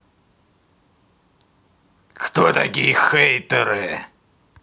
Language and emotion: Russian, angry